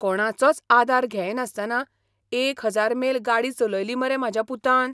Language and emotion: Goan Konkani, surprised